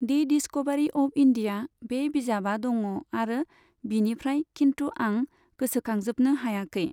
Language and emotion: Bodo, neutral